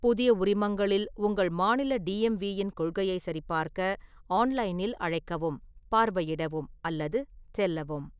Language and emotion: Tamil, neutral